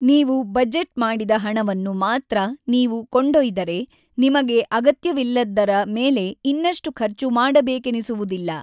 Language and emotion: Kannada, neutral